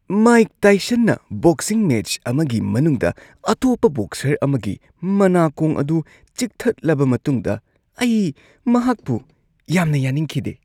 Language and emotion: Manipuri, disgusted